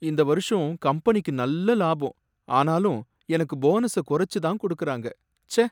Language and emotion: Tamil, sad